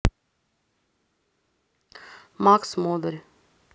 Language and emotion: Russian, neutral